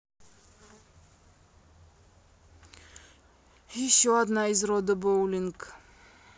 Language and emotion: Russian, sad